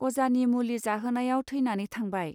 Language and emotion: Bodo, neutral